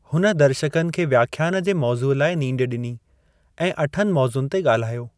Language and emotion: Sindhi, neutral